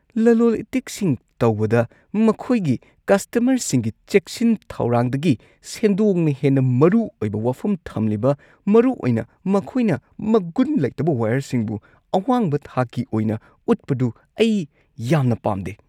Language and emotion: Manipuri, disgusted